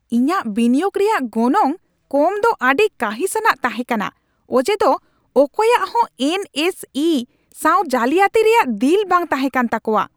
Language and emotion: Santali, angry